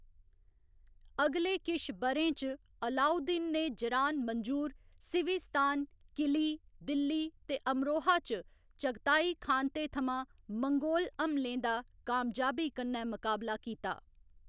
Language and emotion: Dogri, neutral